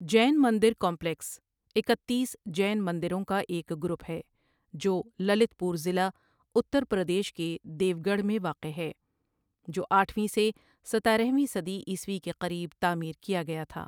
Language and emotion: Urdu, neutral